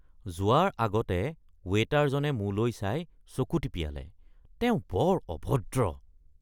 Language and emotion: Assamese, disgusted